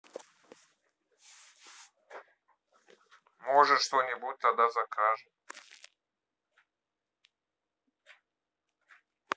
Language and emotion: Russian, neutral